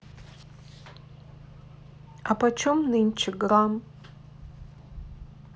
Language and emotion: Russian, sad